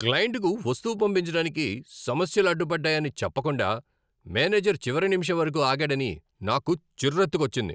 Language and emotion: Telugu, angry